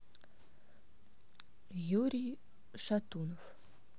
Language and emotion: Russian, neutral